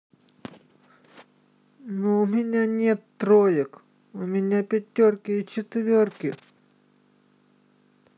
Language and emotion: Russian, neutral